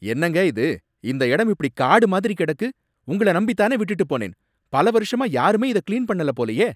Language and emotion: Tamil, angry